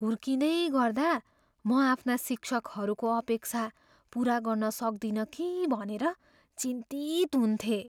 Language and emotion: Nepali, fearful